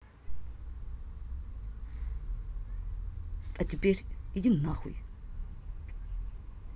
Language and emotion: Russian, angry